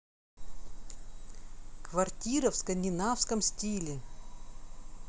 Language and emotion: Russian, neutral